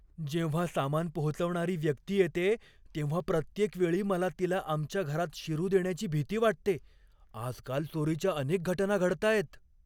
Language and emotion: Marathi, fearful